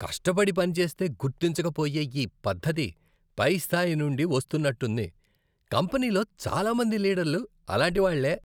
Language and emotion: Telugu, disgusted